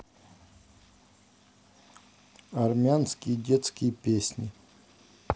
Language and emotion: Russian, neutral